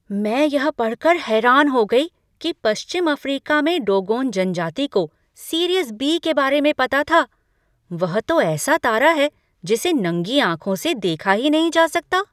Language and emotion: Hindi, surprised